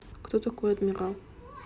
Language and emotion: Russian, neutral